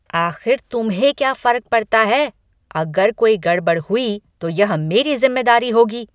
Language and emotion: Hindi, angry